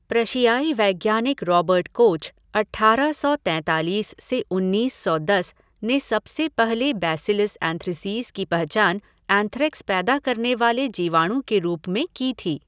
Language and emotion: Hindi, neutral